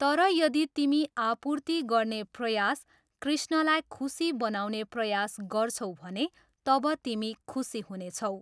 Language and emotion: Nepali, neutral